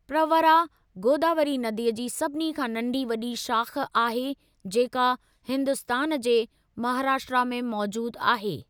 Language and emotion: Sindhi, neutral